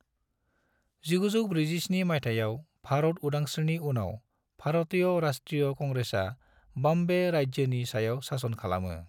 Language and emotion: Bodo, neutral